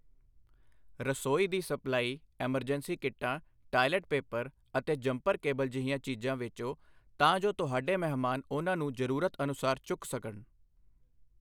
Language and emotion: Punjabi, neutral